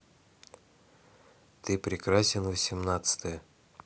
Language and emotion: Russian, neutral